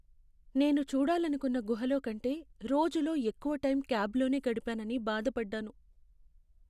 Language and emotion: Telugu, sad